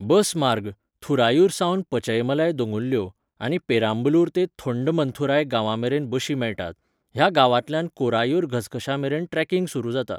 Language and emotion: Goan Konkani, neutral